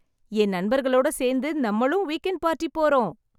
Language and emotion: Tamil, happy